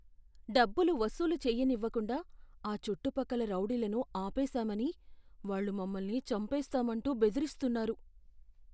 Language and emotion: Telugu, fearful